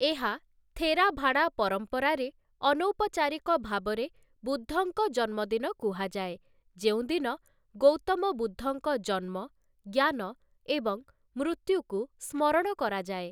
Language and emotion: Odia, neutral